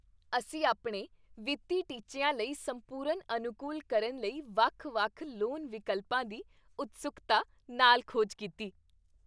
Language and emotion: Punjabi, happy